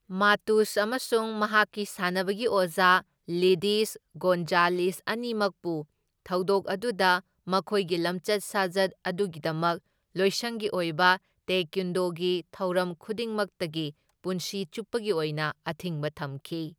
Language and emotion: Manipuri, neutral